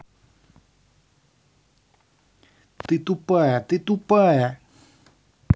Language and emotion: Russian, angry